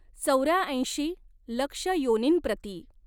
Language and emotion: Marathi, neutral